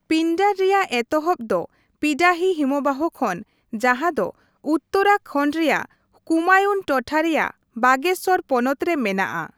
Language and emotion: Santali, neutral